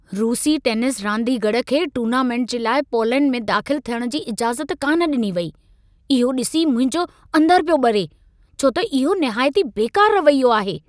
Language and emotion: Sindhi, angry